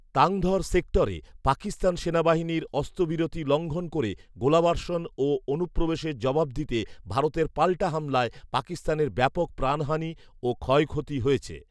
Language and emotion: Bengali, neutral